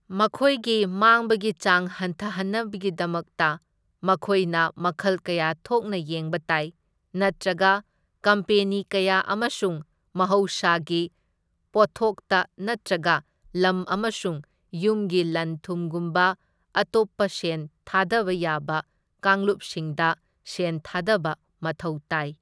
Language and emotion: Manipuri, neutral